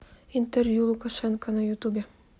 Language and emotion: Russian, neutral